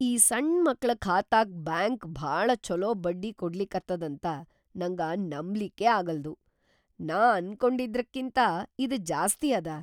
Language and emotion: Kannada, surprised